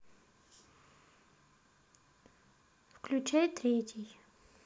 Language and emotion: Russian, neutral